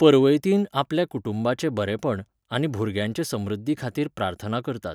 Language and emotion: Goan Konkani, neutral